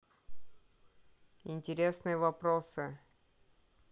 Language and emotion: Russian, neutral